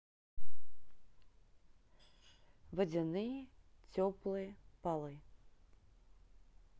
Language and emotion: Russian, neutral